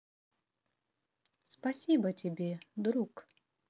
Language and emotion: Russian, positive